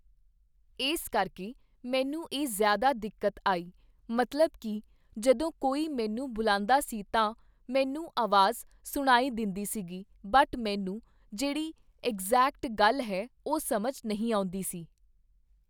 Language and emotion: Punjabi, neutral